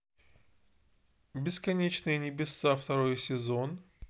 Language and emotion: Russian, neutral